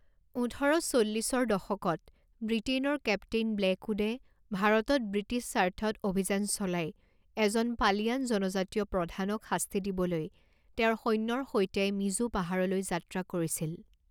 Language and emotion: Assamese, neutral